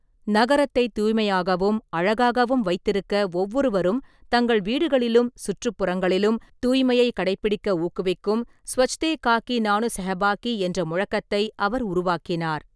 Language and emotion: Tamil, neutral